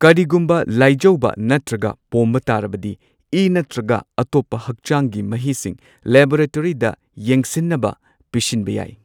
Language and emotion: Manipuri, neutral